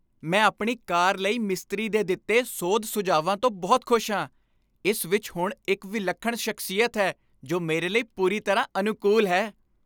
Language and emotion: Punjabi, happy